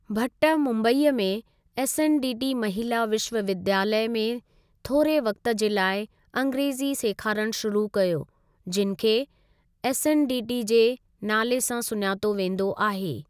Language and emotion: Sindhi, neutral